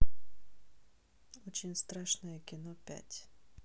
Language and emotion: Russian, neutral